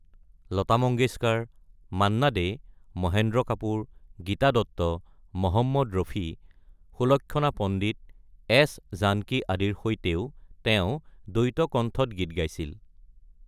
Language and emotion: Assamese, neutral